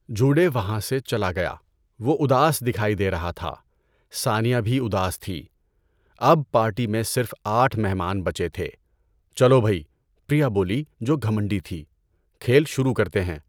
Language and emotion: Urdu, neutral